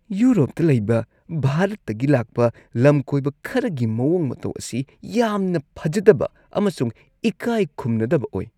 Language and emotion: Manipuri, disgusted